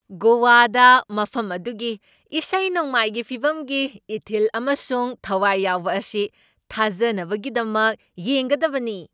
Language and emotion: Manipuri, surprised